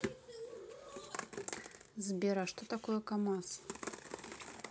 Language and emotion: Russian, neutral